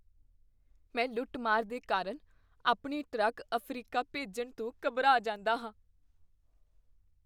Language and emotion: Punjabi, fearful